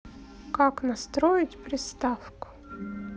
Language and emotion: Russian, neutral